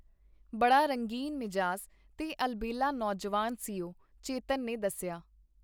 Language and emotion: Punjabi, neutral